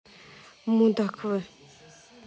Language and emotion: Russian, neutral